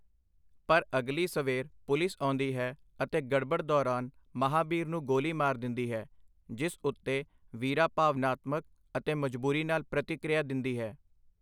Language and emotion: Punjabi, neutral